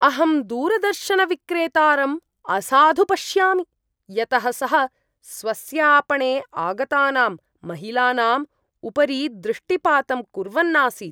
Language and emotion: Sanskrit, disgusted